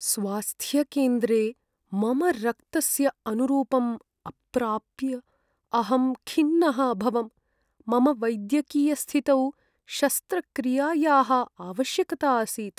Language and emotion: Sanskrit, sad